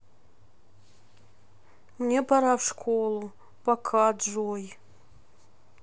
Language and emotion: Russian, sad